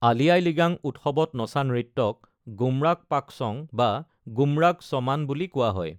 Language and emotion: Assamese, neutral